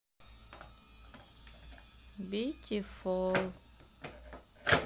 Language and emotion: Russian, sad